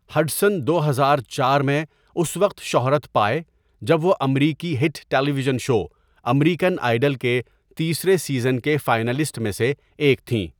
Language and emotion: Urdu, neutral